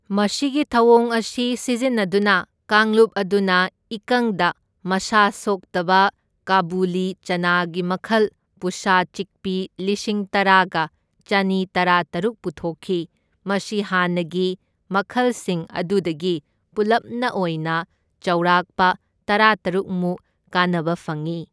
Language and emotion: Manipuri, neutral